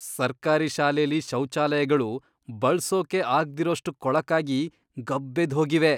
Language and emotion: Kannada, disgusted